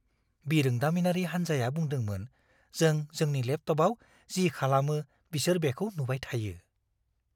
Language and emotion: Bodo, fearful